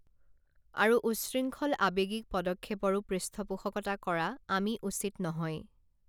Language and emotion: Assamese, neutral